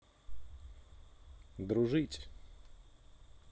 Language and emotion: Russian, neutral